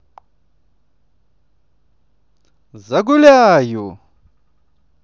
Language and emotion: Russian, positive